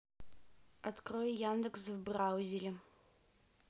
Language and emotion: Russian, neutral